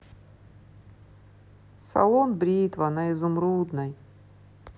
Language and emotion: Russian, sad